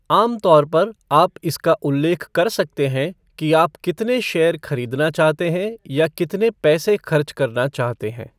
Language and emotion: Hindi, neutral